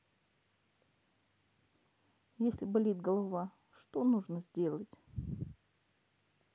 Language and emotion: Russian, sad